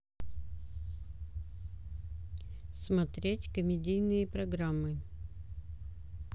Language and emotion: Russian, neutral